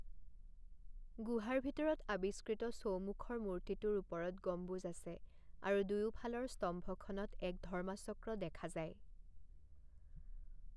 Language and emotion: Assamese, neutral